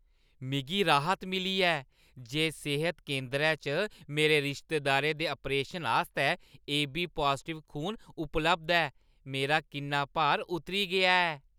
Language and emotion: Dogri, happy